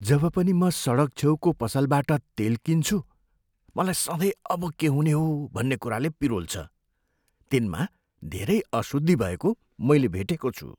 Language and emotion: Nepali, fearful